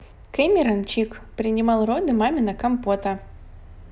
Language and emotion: Russian, positive